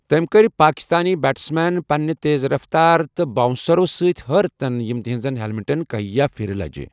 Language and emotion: Kashmiri, neutral